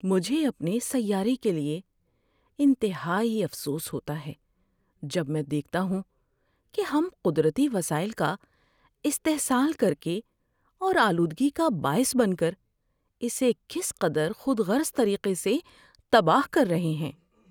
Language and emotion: Urdu, sad